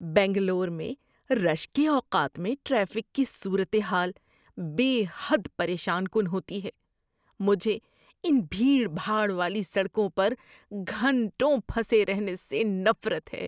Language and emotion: Urdu, disgusted